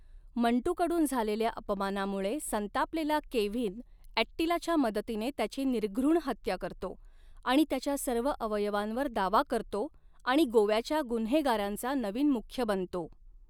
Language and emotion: Marathi, neutral